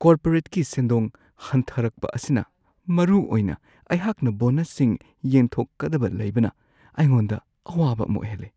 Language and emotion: Manipuri, fearful